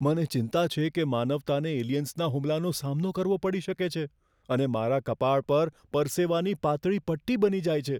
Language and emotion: Gujarati, fearful